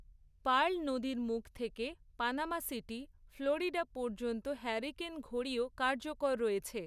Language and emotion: Bengali, neutral